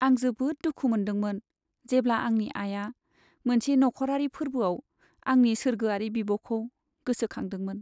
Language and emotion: Bodo, sad